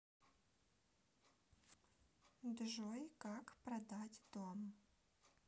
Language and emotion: Russian, neutral